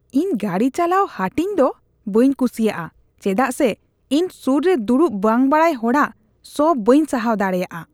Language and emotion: Santali, disgusted